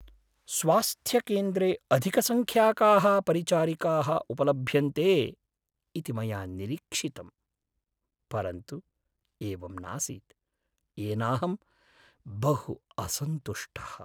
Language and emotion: Sanskrit, sad